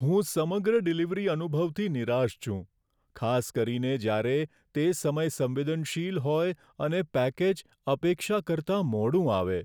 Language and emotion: Gujarati, sad